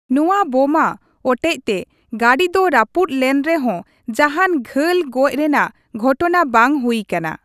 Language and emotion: Santali, neutral